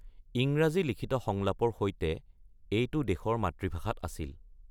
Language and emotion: Assamese, neutral